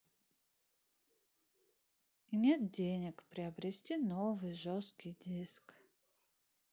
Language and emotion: Russian, sad